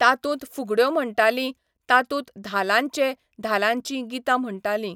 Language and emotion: Goan Konkani, neutral